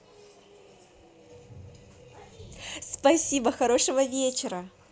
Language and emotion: Russian, positive